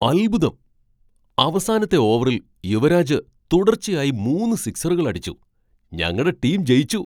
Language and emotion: Malayalam, surprised